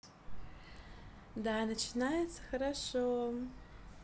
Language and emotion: Russian, positive